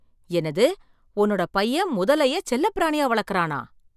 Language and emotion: Tamil, surprised